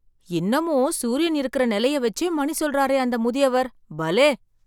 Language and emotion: Tamil, surprised